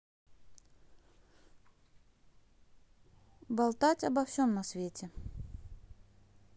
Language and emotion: Russian, neutral